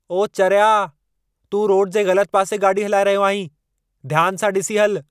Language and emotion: Sindhi, angry